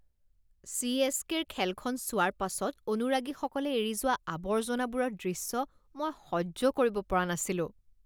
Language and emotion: Assamese, disgusted